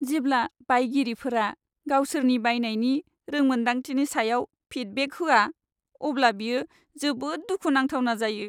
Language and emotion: Bodo, sad